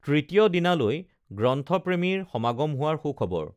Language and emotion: Assamese, neutral